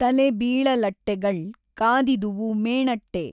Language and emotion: Kannada, neutral